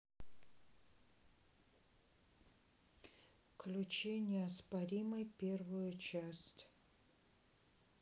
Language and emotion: Russian, neutral